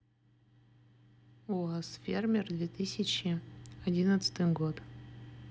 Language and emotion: Russian, neutral